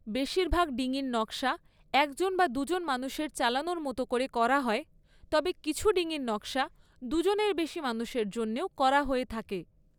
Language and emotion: Bengali, neutral